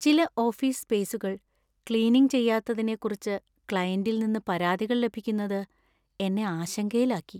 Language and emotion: Malayalam, sad